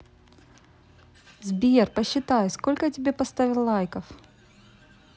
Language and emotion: Russian, positive